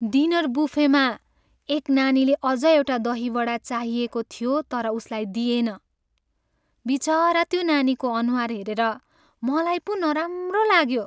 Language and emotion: Nepali, sad